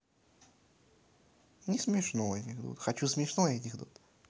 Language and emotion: Russian, neutral